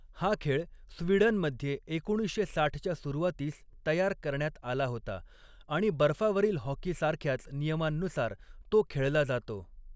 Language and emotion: Marathi, neutral